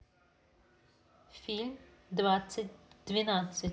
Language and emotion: Russian, neutral